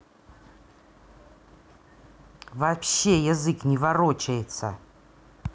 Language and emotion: Russian, angry